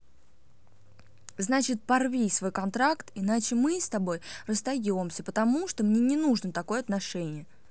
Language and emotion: Russian, angry